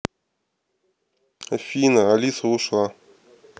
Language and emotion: Russian, neutral